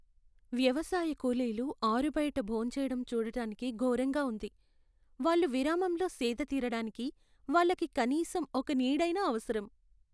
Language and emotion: Telugu, sad